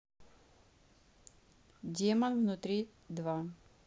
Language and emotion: Russian, neutral